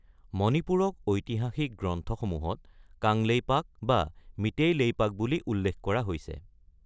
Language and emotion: Assamese, neutral